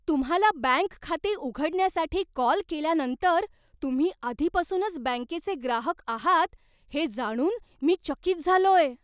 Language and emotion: Marathi, surprised